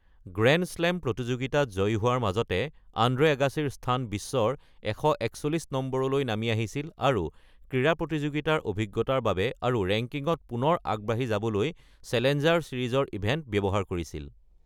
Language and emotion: Assamese, neutral